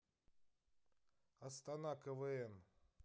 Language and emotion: Russian, neutral